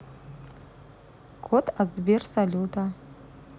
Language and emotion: Russian, neutral